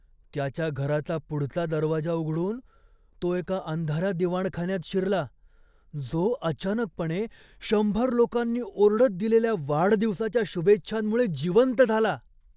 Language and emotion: Marathi, surprised